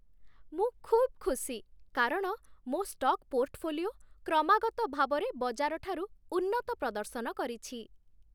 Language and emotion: Odia, happy